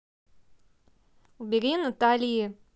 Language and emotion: Russian, angry